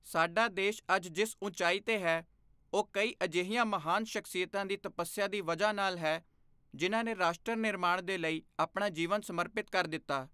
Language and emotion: Punjabi, neutral